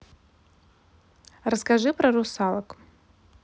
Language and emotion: Russian, neutral